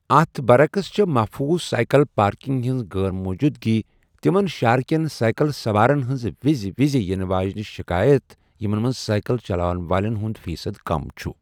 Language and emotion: Kashmiri, neutral